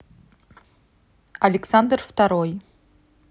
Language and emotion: Russian, neutral